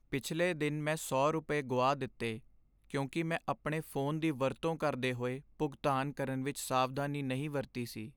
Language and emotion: Punjabi, sad